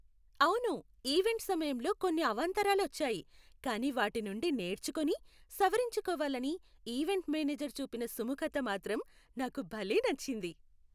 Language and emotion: Telugu, happy